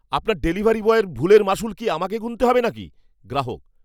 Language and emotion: Bengali, angry